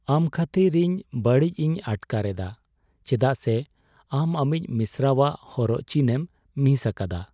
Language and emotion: Santali, sad